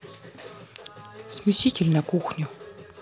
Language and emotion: Russian, neutral